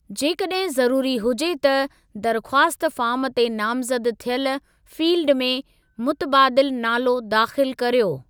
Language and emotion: Sindhi, neutral